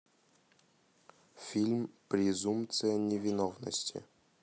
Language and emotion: Russian, neutral